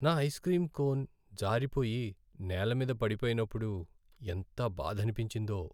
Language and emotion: Telugu, sad